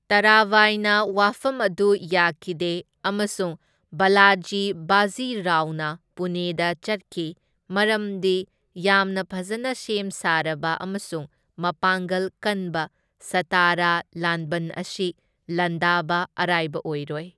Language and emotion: Manipuri, neutral